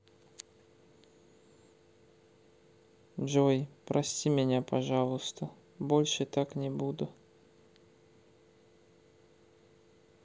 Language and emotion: Russian, neutral